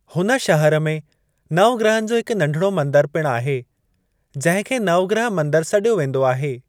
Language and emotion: Sindhi, neutral